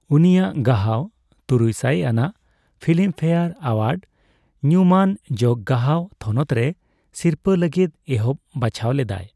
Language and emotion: Santali, neutral